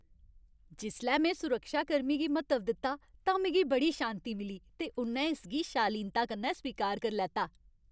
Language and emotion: Dogri, happy